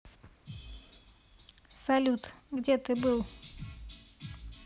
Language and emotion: Russian, neutral